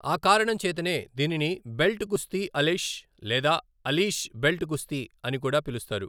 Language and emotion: Telugu, neutral